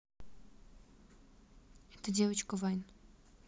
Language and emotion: Russian, neutral